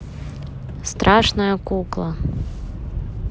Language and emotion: Russian, neutral